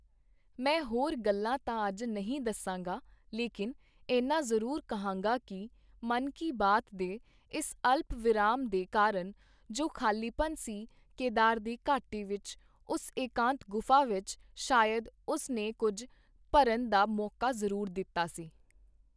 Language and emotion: Punjabi, neutral